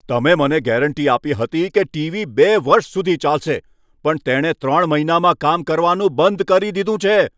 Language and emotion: Gujarati, angry